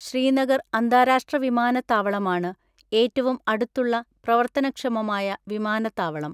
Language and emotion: Malayalam, neutral